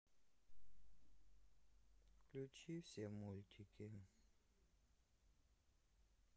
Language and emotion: Russian, sad